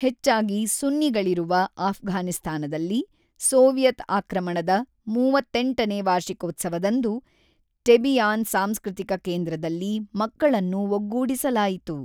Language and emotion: Kannada, neutral